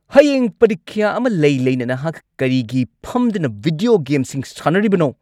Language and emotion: Manipuri, angry